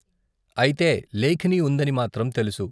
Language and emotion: Telugu, neutral